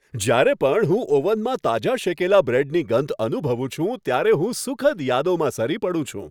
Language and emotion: Gujarati, happy